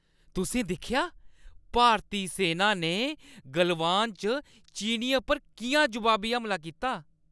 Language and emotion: Dogri, happy